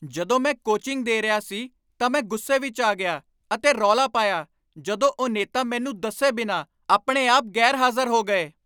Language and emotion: Punjabi, angry